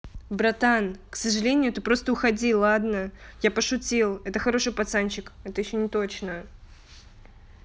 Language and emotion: Russian, neutral